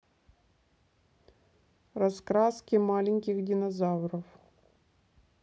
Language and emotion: Russian, neutral